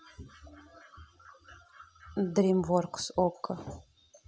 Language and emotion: Russian, neutral